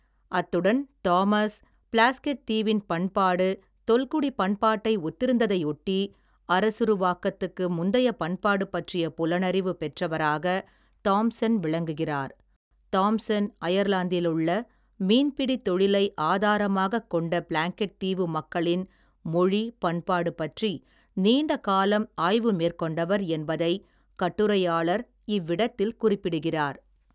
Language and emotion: Tamil, neutral